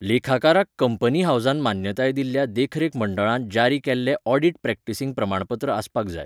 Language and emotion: Goan Konkani, neutral